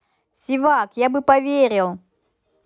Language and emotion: Russian, positive